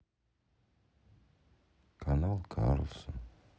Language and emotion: Russian, sad